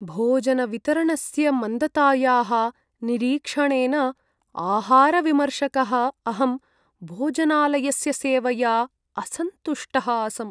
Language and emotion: Sanskrit, sad